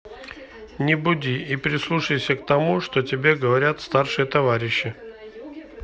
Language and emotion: Russian, neutral